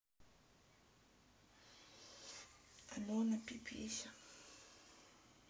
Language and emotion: Russian, sad